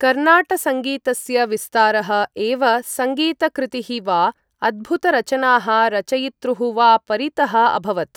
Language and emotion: Sanskrit, neutral